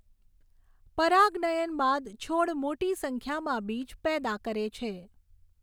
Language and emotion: Gujarati, neutral